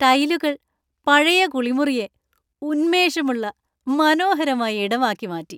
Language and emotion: Malayalam, happy